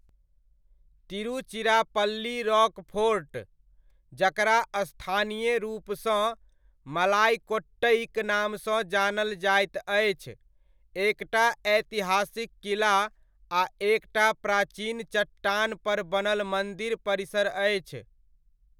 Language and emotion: Maithili, neutral